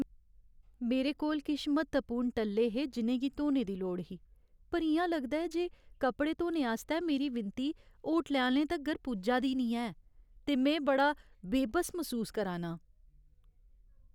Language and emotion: Dogri, sad